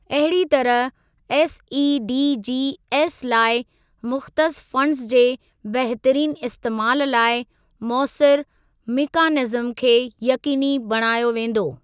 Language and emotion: Sindhi, neutral